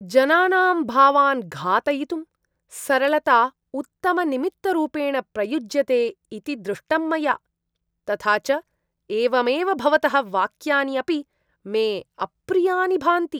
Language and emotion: Sanskrit, disgusted